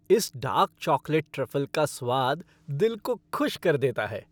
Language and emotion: Hindi, happy